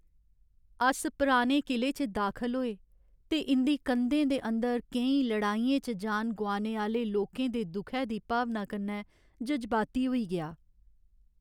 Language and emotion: Dogri, sad